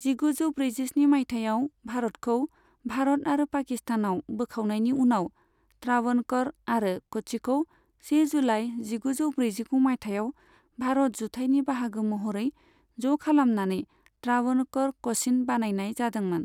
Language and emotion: Bodo, neutral